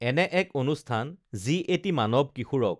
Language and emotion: Assamese, neutral